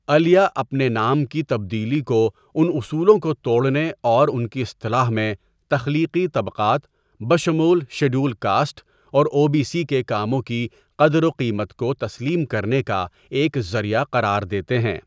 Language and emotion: Urdu, neutral